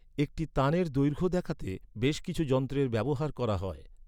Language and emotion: Bengali, neutral